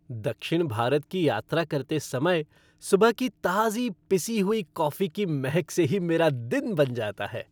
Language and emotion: Hindi, happy